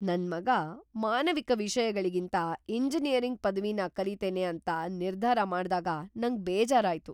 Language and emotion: Kannada, surprised